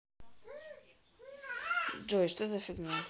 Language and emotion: Russian, neutral